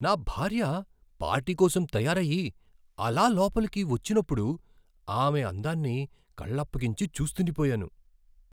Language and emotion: Telugu, surprised